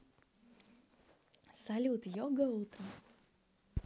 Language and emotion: Russian, positive